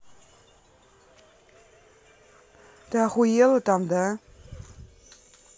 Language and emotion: Russian, angry